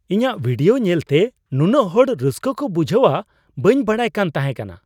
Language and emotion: Santali, surprised